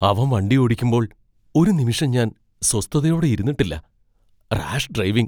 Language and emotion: Malayalam, fearful